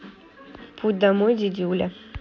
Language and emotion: Russian, neutral